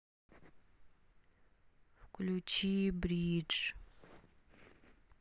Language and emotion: Russian, neutral